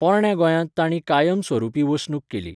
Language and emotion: Goan Konkani, neutral